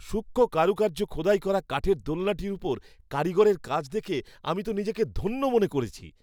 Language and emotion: Bengali, happy